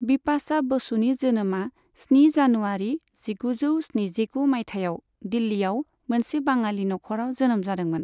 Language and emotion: Bodo, neutral